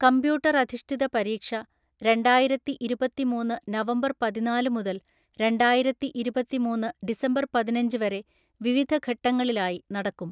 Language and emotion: Malayalam, neutral